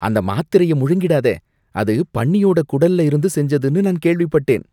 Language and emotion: Tamil, disgusted